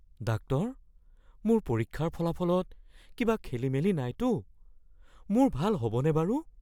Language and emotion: Assamese, fearful